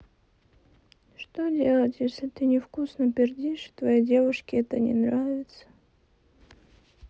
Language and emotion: Russian, sad